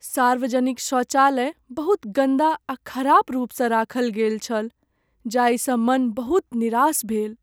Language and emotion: Maithili, sad